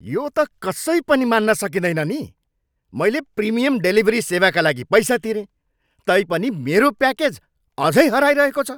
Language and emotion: Nepali, angry